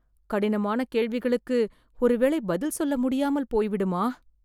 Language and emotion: Tamil, fearful